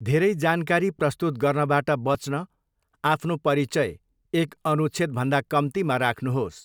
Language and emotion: Nepali, neutral